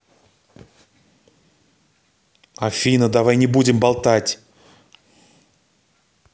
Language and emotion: Russian, angry